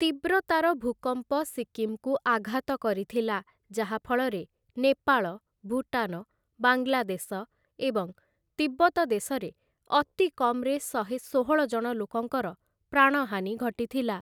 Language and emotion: Odia, neutral